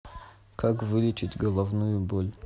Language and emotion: Russian, neutral